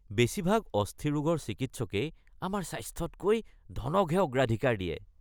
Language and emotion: Assamese, disgusted